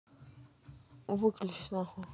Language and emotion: Russian, neutral